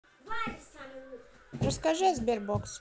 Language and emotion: Russian, neutral